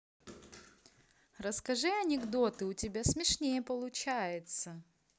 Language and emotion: Russian, positive